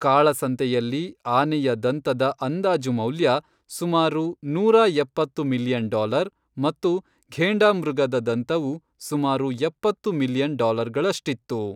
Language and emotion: Kannada, neutral